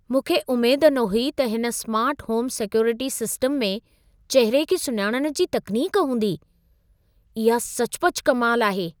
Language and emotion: Sindhi, surprised